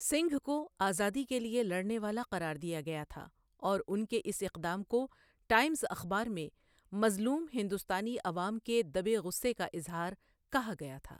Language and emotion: Urdu, neutral